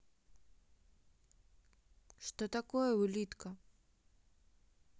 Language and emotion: Russian, neutral